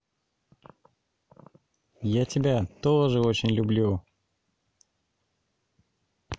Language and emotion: Russian, positive